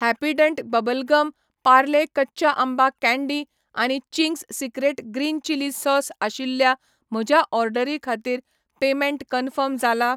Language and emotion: Goan Konkani, neutral